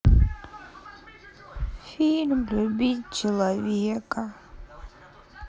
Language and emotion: Russian, sad